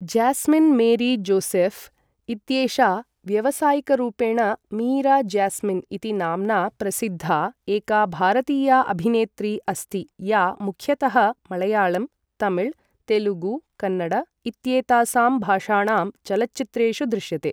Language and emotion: Sanskrit, neutral